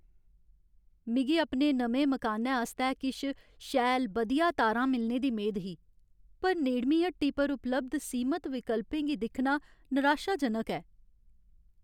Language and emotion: Dogri, sad